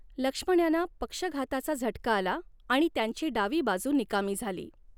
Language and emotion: Marathi, neutral